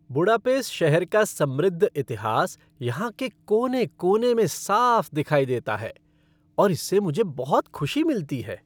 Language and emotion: Hindi, happy